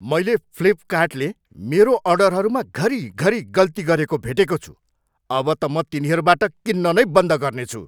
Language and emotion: Nepali, angry